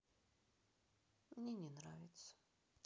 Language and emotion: Russian, sad